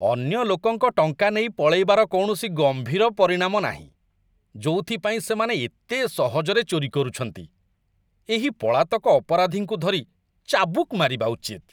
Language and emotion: Odia, disgusted